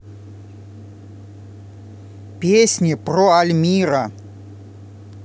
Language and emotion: Russian, positive